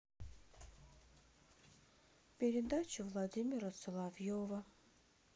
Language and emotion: Russian, sad